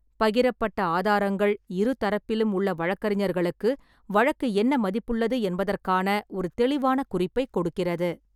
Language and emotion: Tamil, neutral